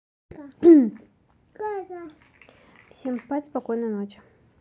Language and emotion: Russian, neutral